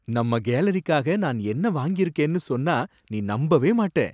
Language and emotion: Tamil, surprised